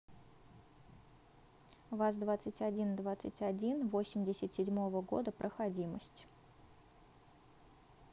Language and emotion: Russian, neutral